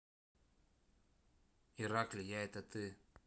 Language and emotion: Russian, neutral